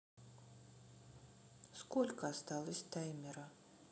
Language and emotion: Russian, neutral